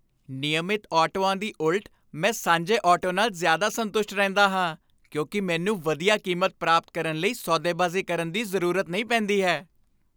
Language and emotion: Punjabi, happy